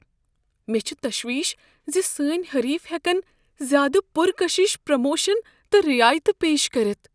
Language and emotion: Kashmiri, fearful